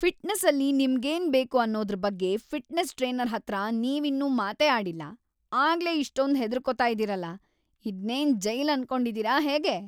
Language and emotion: Kannada, angry